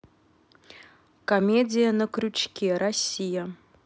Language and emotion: Russian, neutral